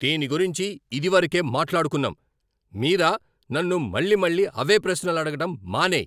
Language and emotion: Telugu, angry